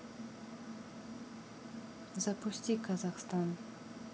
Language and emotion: Russian, neutral